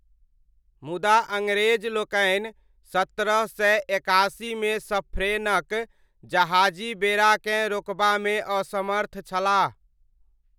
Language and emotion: Maithili, neutral